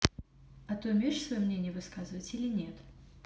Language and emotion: Russian, neutral